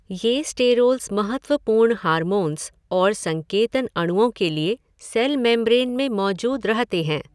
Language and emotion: Hindi, neutral